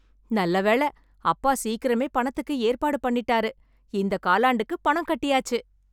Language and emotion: Tamil, happy